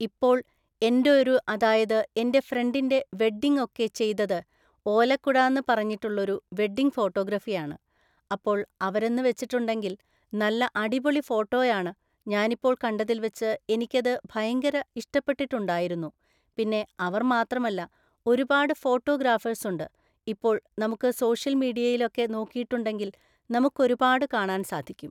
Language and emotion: Malayalam, neutral